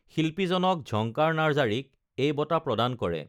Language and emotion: Assamese, neutral